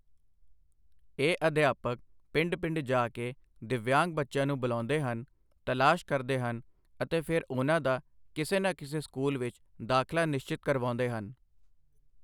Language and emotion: Punjabi, neutral